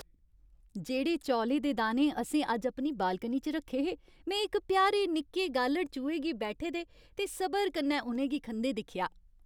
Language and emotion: Dogri, happy